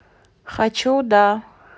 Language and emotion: Russian, neutral